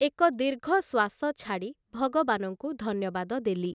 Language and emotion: Odia, neutral